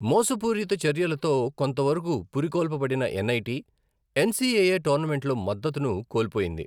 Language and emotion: Telugu, neutral